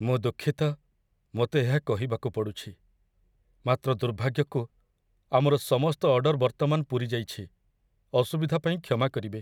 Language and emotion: Odia, sad